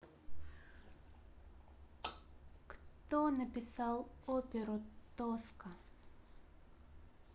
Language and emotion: Russian, neutral